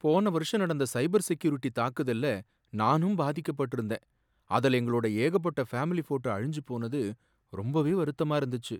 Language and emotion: Tamil, sad